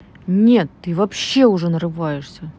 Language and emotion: Russian, angry